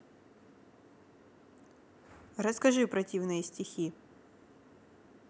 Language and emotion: Russian, neutral